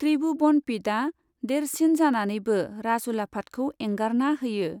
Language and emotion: Bodo, neutral